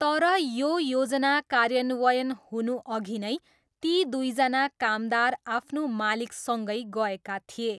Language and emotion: Nepali, neutral